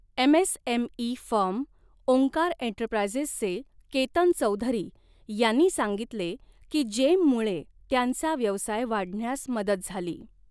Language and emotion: Marathi, neutral